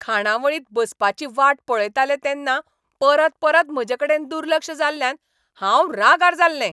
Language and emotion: Goan Konkani, angry